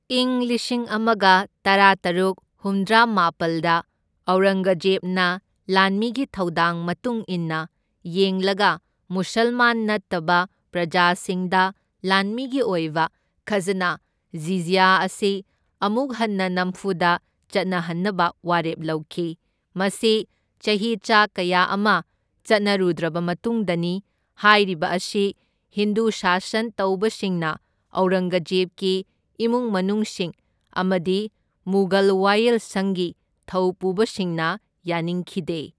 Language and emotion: Manipuri, neutral